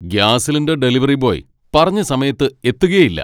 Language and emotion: Malayalam, angry